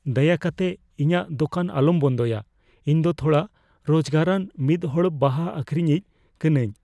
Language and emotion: Santali, fearful